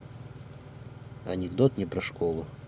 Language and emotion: Russian, neutral